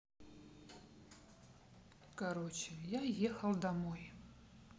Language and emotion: Russian, neutral